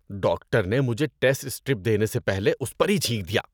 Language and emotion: Urdu, disgusted